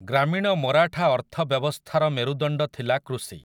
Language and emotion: Odia, neutral